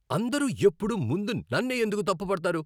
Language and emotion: Telugu, angry